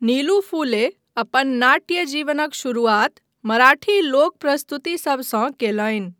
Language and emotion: Maithili, neutral